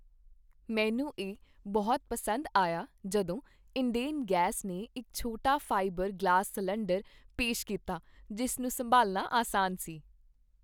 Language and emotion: Punjabi, happy